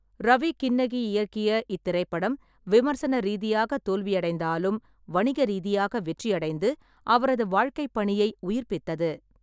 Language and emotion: Tamil, neutral